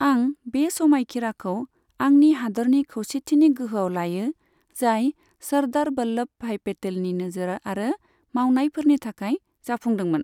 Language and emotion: Bodo, neutral